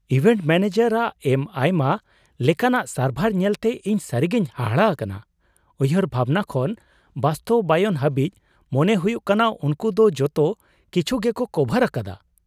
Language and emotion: Santali, surprised